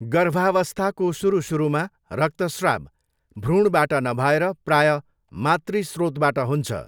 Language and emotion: Nepali, neutral